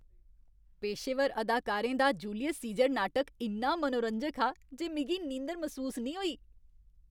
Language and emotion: Dogri, happy